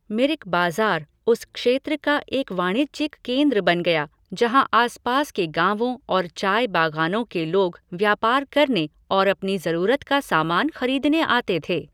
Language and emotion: Hindi, neutral